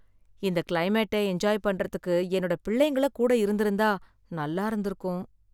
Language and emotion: Tamil, sad